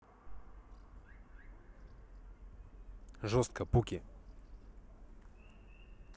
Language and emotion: Russian, neutral